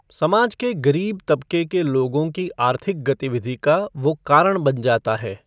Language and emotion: Hindi, neutral